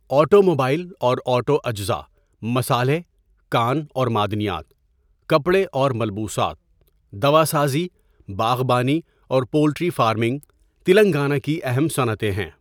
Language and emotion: Urdu, neutral